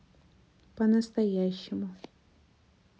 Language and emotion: Russian, neutral